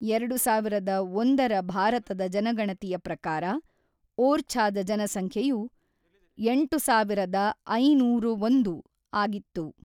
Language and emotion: Kannada, neutral